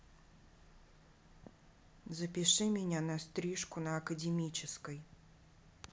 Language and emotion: Russian, neutral